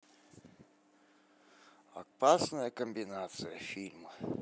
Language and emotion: Russian, neutral